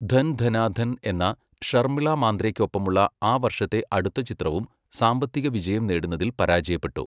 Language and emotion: Malayalam, neutral